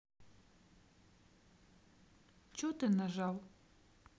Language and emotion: Russian, sad